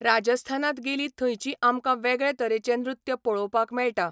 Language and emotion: Goan Konkani, neutral